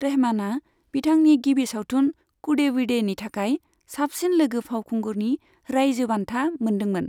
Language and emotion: Bodo, neutral